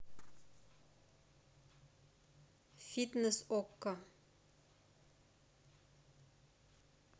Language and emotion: Russian, neutral